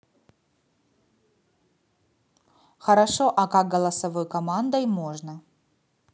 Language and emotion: Russian, neutral